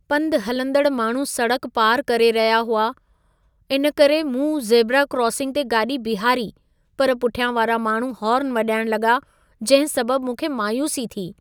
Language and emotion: Sindhi, sad